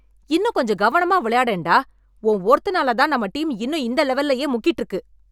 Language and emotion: Tamil, angry